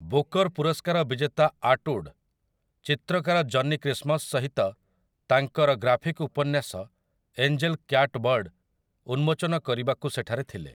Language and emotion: Odia, neutral